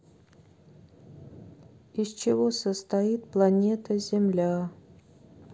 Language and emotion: Russian, sad